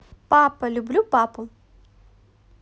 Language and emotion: Russian, positive